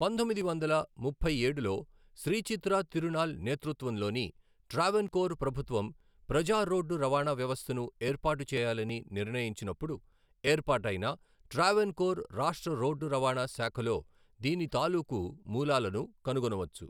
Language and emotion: Telugu, neutral